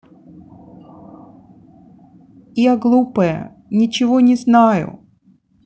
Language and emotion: Russian, sad